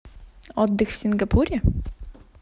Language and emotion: Russian, positive